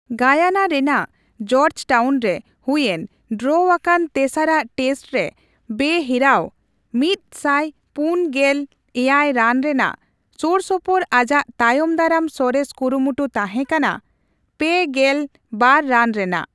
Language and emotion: Santali, neutral